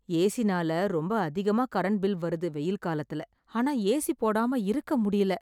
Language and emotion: Tamil, sad